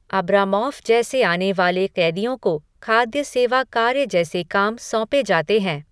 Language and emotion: Hindi, neutral